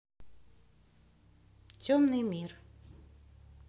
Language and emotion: Russian, neutral